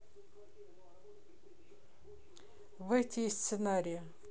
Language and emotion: Russian, neutral